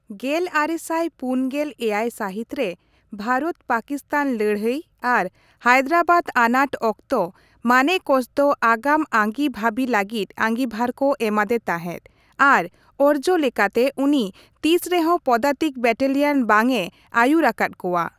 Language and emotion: Santali, neutral